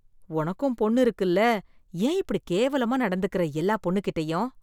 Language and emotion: Tamil, disgusted